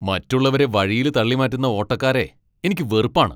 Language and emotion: Malayalam, angry